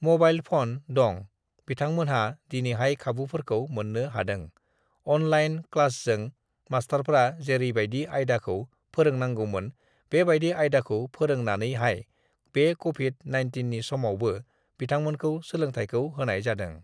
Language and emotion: Bodo, neutral